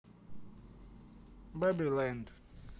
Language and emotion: Russian, neutral